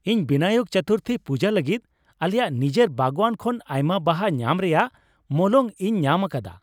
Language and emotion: Santali, happy